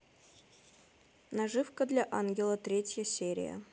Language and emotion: Russian, neutral